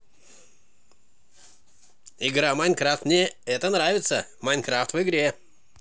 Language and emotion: Russian, positive